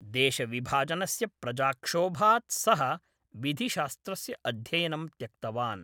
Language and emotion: Sanskrit, neutral